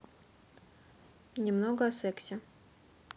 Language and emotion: Russian, neutral